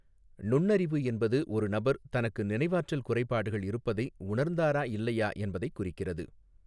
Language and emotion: Tamil, neutral